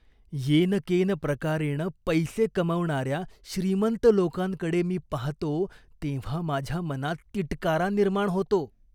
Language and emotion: Marathi, disgusted